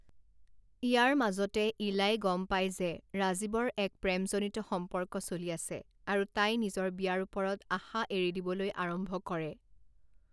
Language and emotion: Assamese, neutral